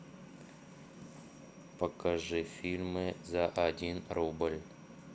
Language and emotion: Russian, neutral